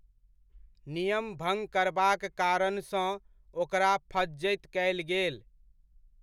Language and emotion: Maithili, neutral